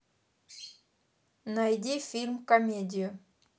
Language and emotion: Russian, neutral